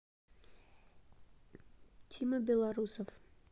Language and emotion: Russian, neutral